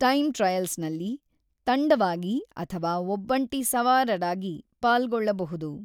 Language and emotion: Kannada, neutral